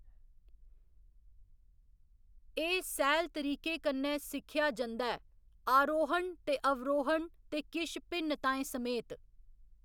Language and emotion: Dogri, neutral